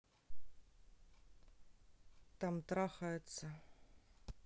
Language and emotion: Russian, neutral